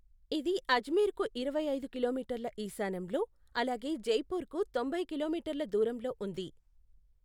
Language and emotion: Telugu, neutral